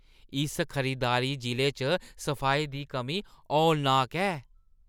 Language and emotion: Dogri, disgusted